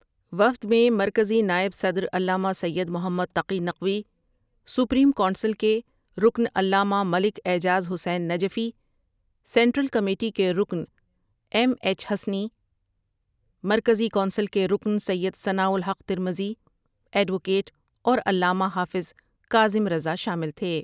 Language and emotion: Urdu, neutral